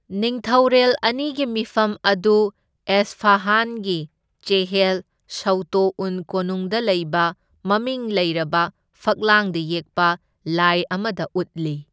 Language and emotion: Manipuri, neutral